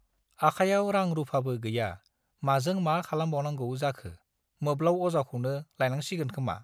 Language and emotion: Bodo, neutral